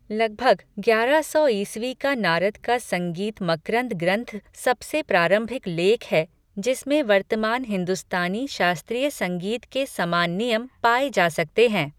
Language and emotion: Hindi, neutral